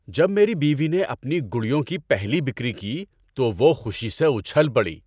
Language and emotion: Urdu, happy